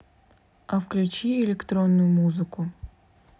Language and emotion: Russian, neutral